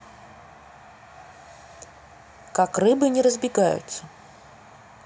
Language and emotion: Russian, neutral